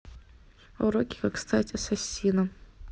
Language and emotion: Russian, neutral